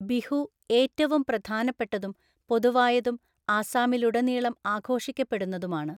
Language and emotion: Malayalam, neutral